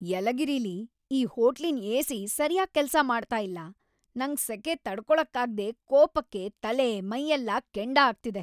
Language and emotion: Kannada, angry